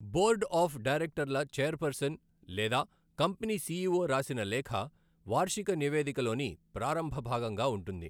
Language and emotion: Telugu, neutral